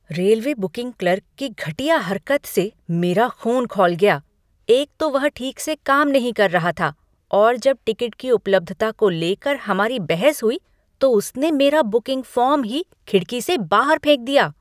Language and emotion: Hindi, angry